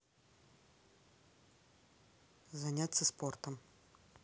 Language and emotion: Russian, neutral